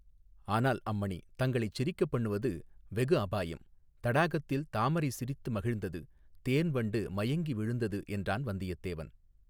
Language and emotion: Tamil, neutral